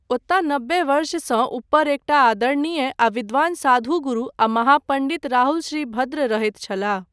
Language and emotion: Maithili, neutral